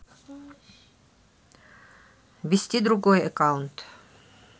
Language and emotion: Russian, neutral